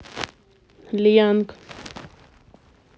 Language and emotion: Russian, neutral